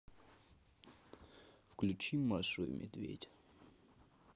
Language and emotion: Russian, neutral